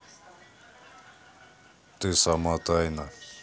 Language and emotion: Russian, neutral